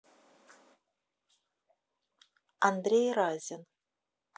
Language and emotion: Russian, neutral